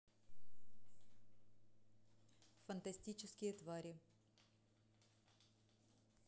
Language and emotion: Russian, neutral